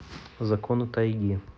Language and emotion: Russian, neutral